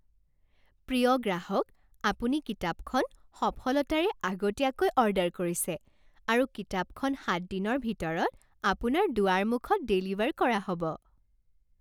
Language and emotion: Assamese, happy